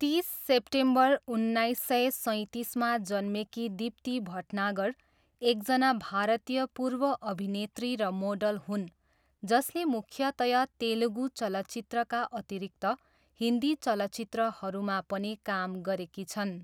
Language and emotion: Nepali, neutral